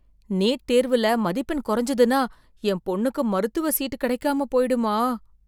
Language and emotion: Tamil, fearful